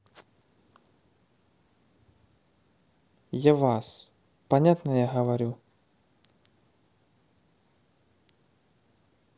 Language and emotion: Russian, neutral